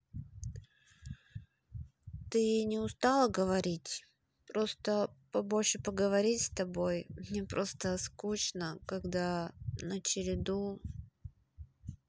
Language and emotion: Russian, sad